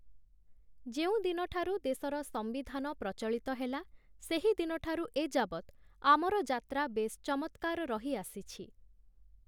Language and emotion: Odia, neutral